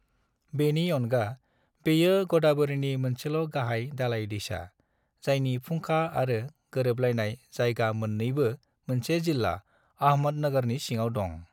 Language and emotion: Bodo, neutral